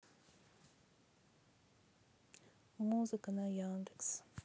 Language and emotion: Russian, sad